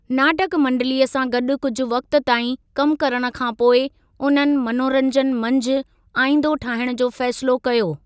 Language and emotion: Sindhi, neutral